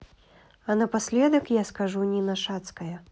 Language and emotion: Russian, neutral